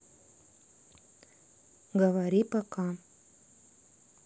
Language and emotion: Russian, neutral